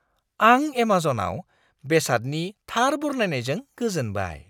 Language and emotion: Bodo, surprised